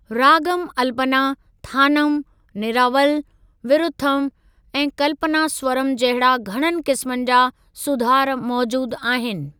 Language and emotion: Sindhi, neutral